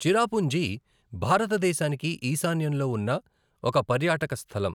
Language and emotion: Telugu, neutral